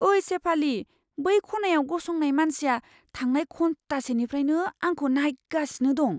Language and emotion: Bodo, fearful